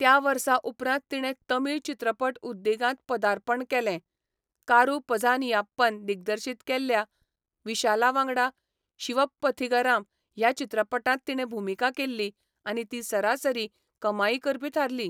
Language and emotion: Goan Konkani, neutral